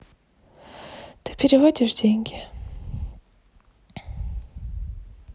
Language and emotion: Russian, sad